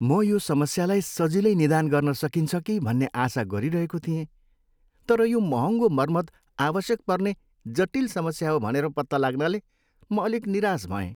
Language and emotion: Nepali, sad